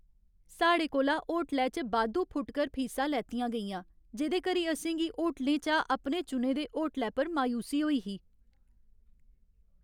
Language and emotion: Dogri, sad